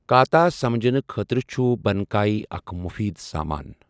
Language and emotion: Kashmiri, neutral